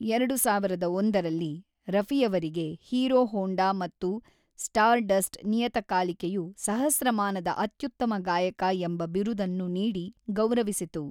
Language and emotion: Kannada, neutral